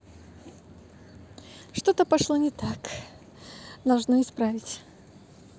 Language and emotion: Russian, positive